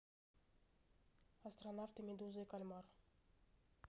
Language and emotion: Russian, neutral